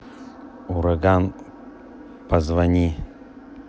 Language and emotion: Russian, neutral